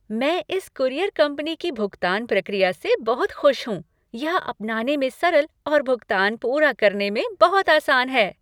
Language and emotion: Hindi, happy